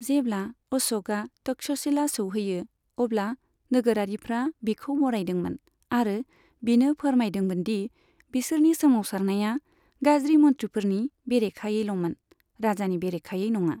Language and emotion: Bodo, neutral